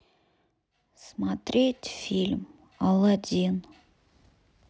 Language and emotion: Russian, sad